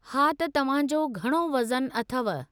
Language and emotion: Sindhi, neutral